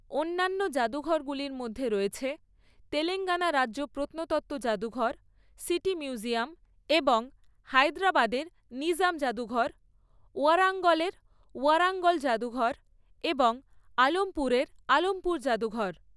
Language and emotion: Bengali, neutral